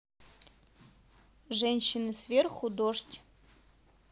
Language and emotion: Russian, neutral